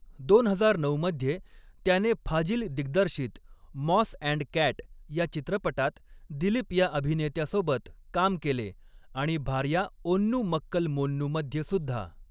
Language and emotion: Marathi, neutral